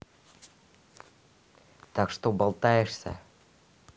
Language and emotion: Russian, neutral